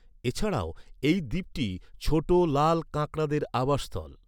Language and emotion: Bengali, neutral